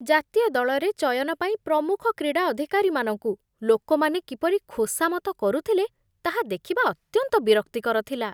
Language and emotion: Odia, disgusted